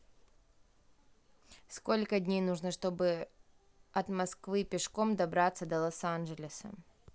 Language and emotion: Russian, neutral